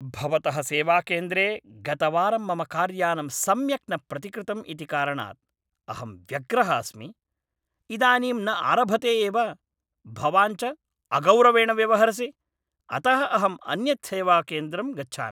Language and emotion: Sanskrit, angry